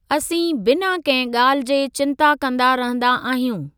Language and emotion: Sindhi, neutral